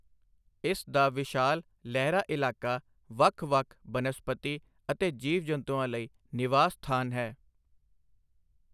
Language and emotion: Punjabi, neutral